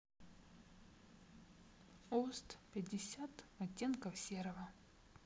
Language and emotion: Russian, sad